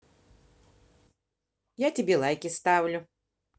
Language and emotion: Russian, positive